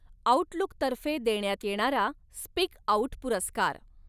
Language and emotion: Marathi, neutral